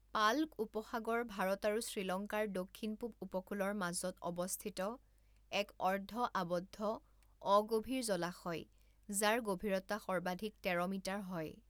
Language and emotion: Assamese, neutral